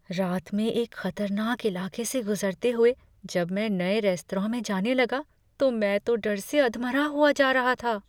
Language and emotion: Hindi, fearful